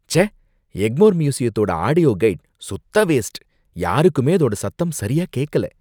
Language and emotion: Tamil, disgusted